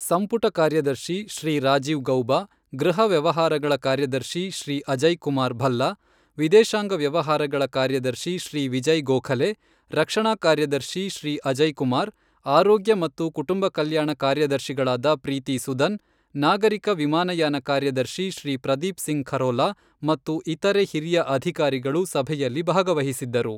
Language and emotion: Kannada, neutral